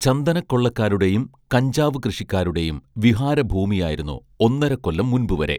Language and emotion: Malayalam, neutral